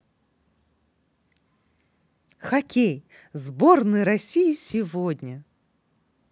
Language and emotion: Russian, positive